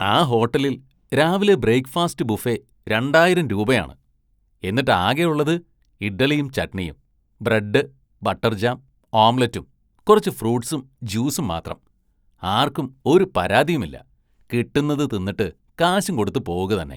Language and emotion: Malayalam, disgusted